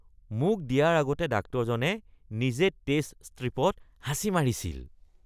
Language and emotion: Assamese, disgusted